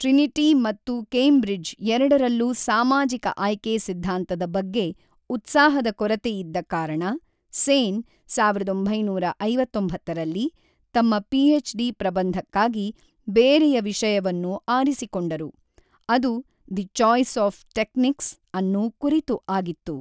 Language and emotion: Kannada, neutral